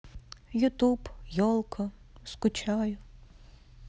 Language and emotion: Russian, sad